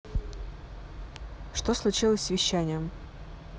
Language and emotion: Russian, neutral